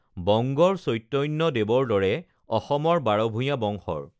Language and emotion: Assamese, neutral